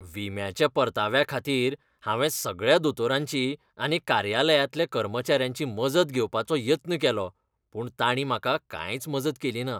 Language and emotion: Goan Konkani, disgusted